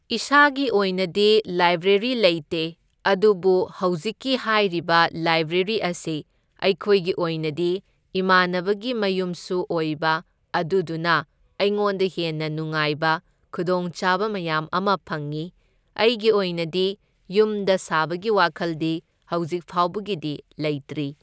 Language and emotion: Manipuri, neutral